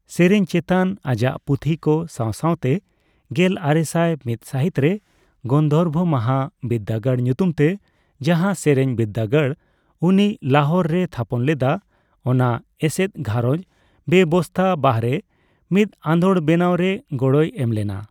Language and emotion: Santali, neutral